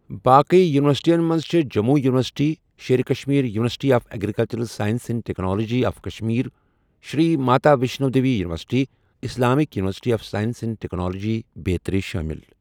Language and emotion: Kashmiri, neutral